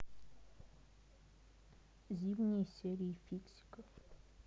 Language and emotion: Russian, neutral